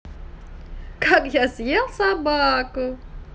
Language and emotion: Russian, positive